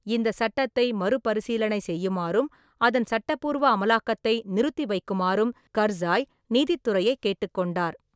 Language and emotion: Tamil, neutral